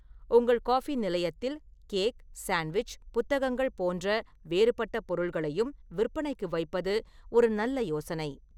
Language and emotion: Tamil, neutral